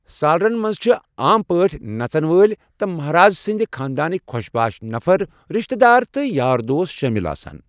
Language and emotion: Kashmiri, neutral